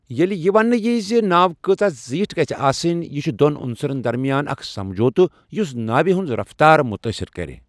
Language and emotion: Kashmiri, neutral